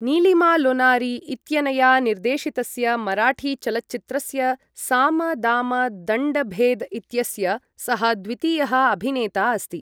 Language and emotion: Sanskrit, neutral